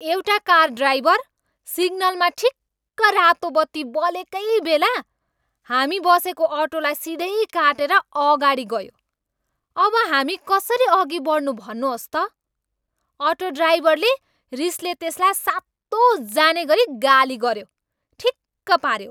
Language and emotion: Nepali, angry